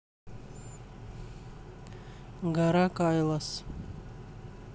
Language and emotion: Russian, neutral